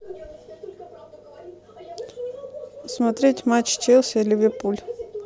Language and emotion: Russian, neutral